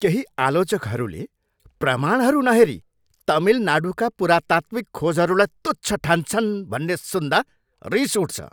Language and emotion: Nepali, angry